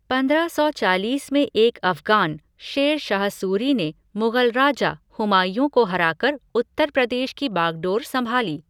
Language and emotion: Hindi, neutral